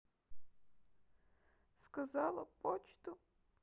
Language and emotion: Russian, sad